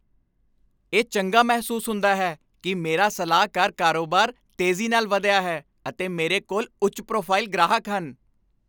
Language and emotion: Punjabi, happy